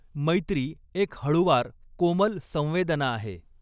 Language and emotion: Marathi, neutral